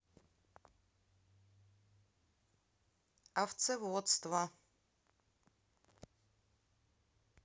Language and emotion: Russian, neutral